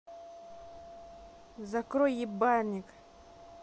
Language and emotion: Russian, angry